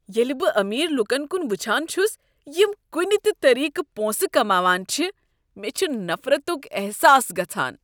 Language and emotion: Kashmiri, disgusted